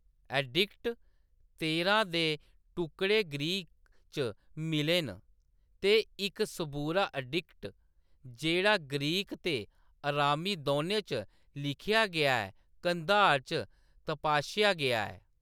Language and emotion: Dogri, neutral